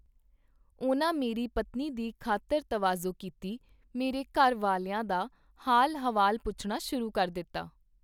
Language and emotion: Punjabi, neutral